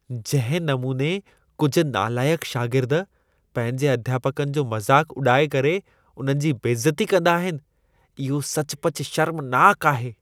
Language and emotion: Sindhi, disgusted